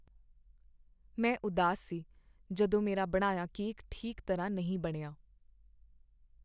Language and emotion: Punjabi, sad